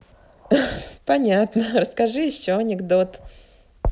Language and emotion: Russian, positive